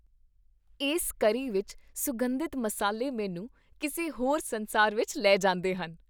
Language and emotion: Punjabi, happy